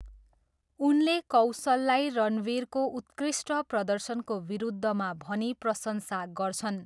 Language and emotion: Nepali, neutral